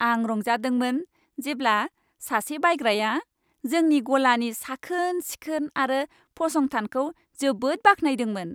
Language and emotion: Bodo, happy